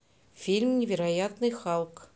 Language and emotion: Russian, neutral